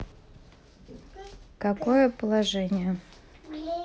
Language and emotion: Russian, neutral